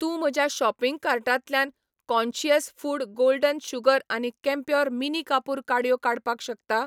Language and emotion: Goan Konkani, neutral